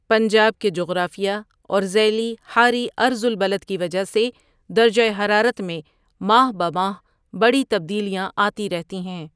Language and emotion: Urdu, neutral